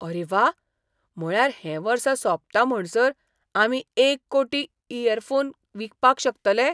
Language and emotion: Goan Konkani, surprised